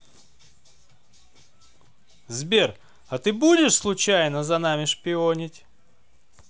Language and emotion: Russian, positive